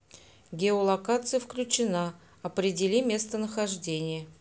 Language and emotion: Russian, neutral